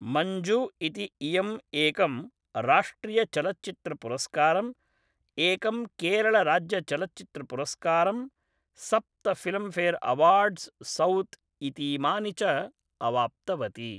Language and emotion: Sanskrit, neutral